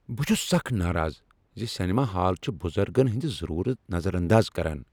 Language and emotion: Kashmiri, angry